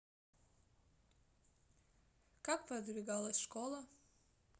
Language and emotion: Russian, neutral